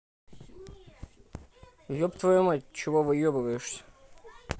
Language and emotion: Russian, angry